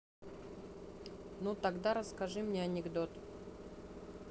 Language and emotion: Russian, neutral